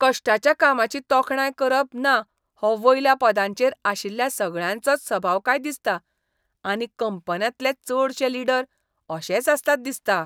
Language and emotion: Goan Konkani, disgusted